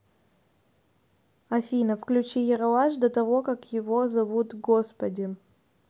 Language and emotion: Russian, neutral